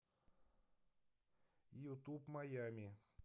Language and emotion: Russian, neutral